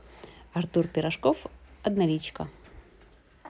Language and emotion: Russian, neutral